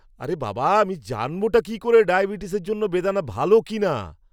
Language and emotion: Bengali, angry